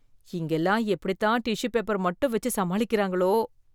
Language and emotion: Tamil, disgusted